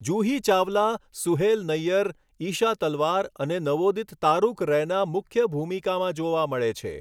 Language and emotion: Gujarati, neutral